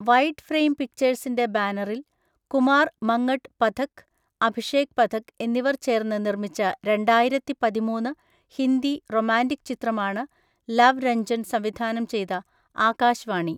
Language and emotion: Malayalam, neutral